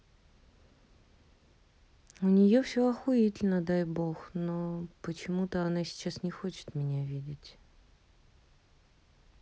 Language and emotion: Russian, sad